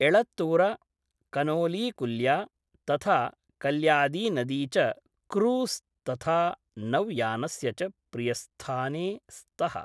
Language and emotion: Sanskrit, neutral